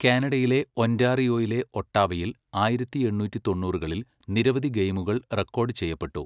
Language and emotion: Malayalam, neutral